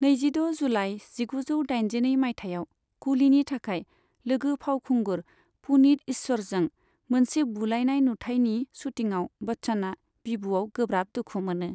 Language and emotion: Bodo, neutral